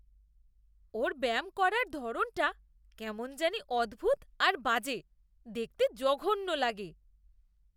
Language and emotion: Bengali, disgusted